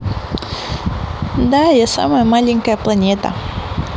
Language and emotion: Russian, neutral